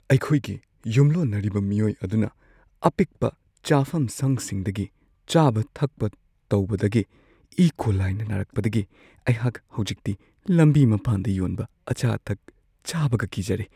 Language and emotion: Manipuri, fearful